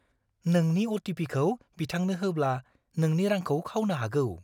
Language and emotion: Bodo, fearful